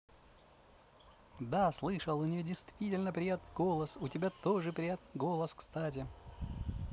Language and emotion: Russian, positive